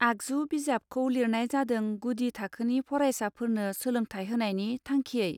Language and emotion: Bodo, neutral